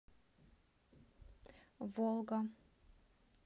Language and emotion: Russian, neutral